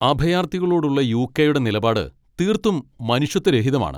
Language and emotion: Malayalam, angry